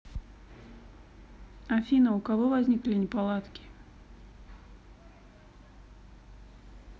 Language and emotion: Russian, neutral